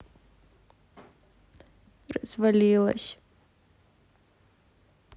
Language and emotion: Russian, sad